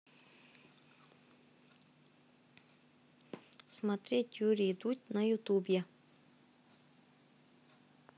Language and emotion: Russian, neutral